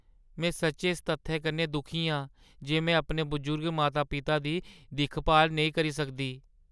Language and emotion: Dogri, sad